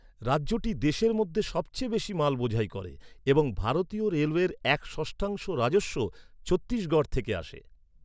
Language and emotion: Bengali, neutral